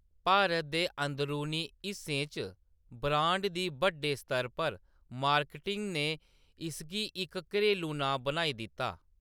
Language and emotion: Dogri, neutral